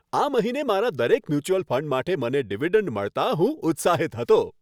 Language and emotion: Gujarati, happy